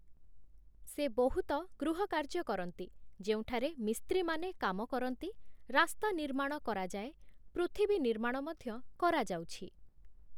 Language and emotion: Odia, neutral